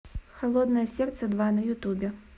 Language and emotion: Russian, neutral